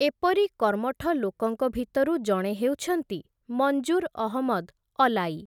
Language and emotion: Odia, neutral